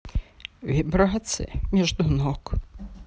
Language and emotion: Russian, sad